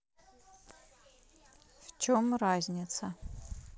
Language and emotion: Russian, neutral